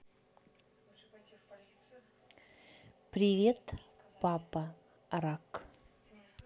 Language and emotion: Russian, neutral